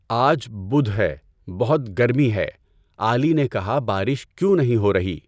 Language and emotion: Urdu, neutral